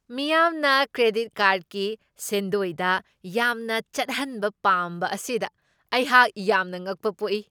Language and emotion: Manipuri, surprised